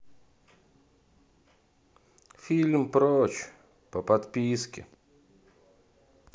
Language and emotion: Russian, sad